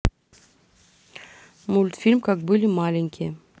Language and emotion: Russian, neutral